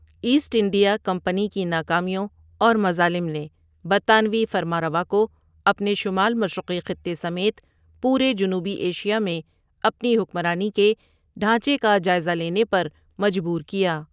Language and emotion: Urdu, neutral